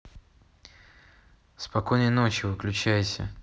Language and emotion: Russian, neutral